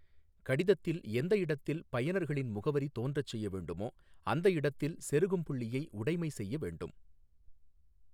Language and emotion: Tamil, neutral